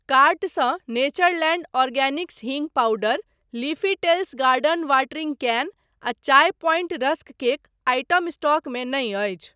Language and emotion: Maithili, neutral